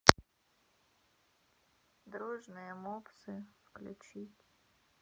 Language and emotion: Russian, sad